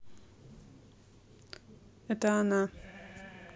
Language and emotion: Russian, neutral